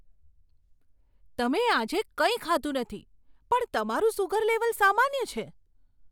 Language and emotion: Gujarati, surprised